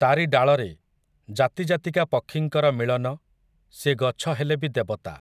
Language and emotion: Odia, neutral